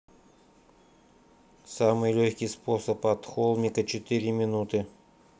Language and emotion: Russian, neutral